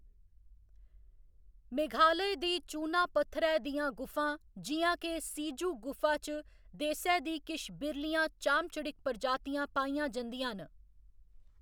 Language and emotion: Dogri, neutral